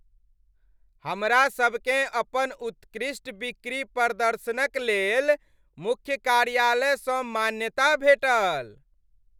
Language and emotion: Maithili, happy